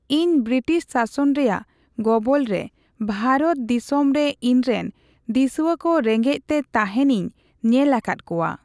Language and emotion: Santali, neutral